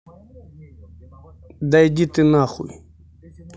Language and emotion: Russian, angry